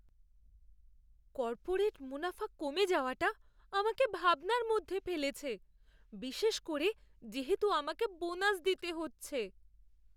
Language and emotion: Bengali, fearful